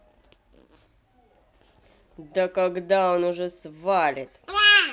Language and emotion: Russian, angry